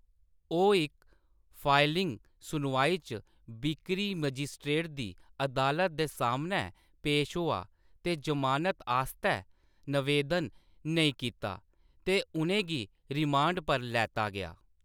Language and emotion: Dogri, neutral